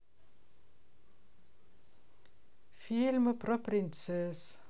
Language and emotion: Russian, sad